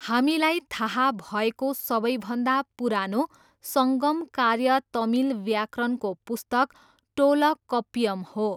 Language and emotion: Nepali, neutral